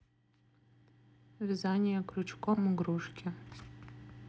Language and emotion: Russian, neutral